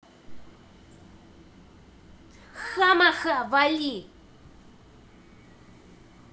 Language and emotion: Russian, angry